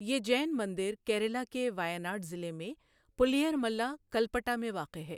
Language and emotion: Urdu, neutral